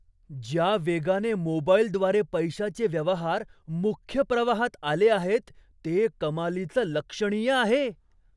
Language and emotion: Marathi, surprised